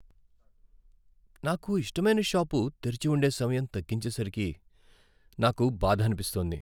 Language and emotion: Telugu, sad